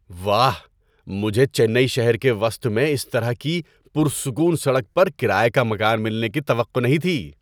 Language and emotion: Urdu, surprised